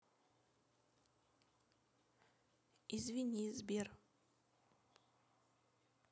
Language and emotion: Russian, neutral